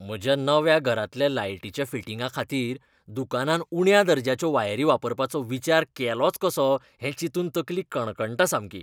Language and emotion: Goan Konkani, disgusted